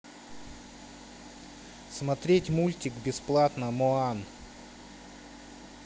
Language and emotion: Russian, neutral